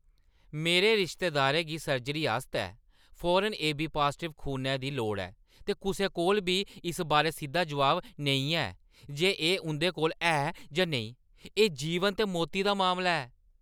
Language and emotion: Dogri, angry